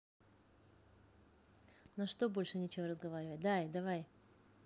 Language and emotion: Russian, neutral